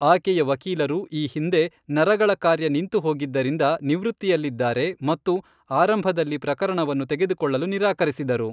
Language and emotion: Kannada, neutral